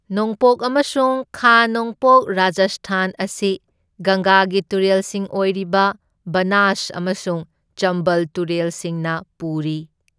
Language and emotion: Manipuri, neutral